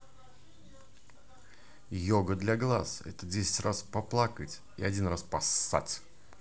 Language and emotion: Russian, positive